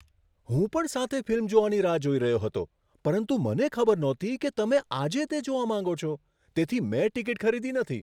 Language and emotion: Gujarati, surprised